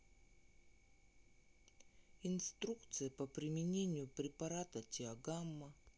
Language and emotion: Russian, sad